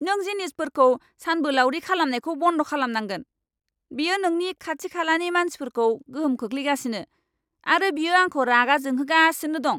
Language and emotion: Bodo, angry